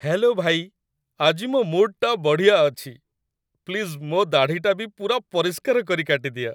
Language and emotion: Odia, happy